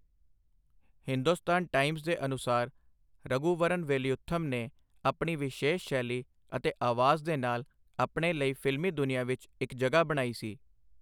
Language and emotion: Punjabi, neutral